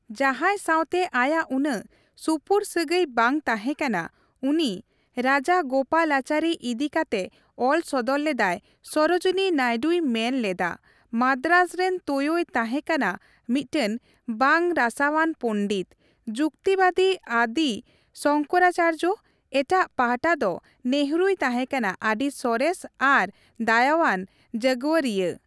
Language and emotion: Santali, neutral